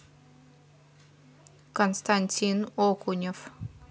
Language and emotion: Russian, neutral